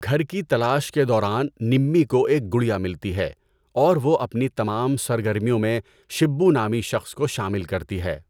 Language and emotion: Urdu, neutral